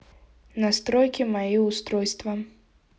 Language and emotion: Russian, neutral